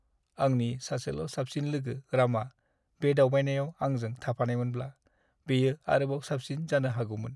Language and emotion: Bodo, sad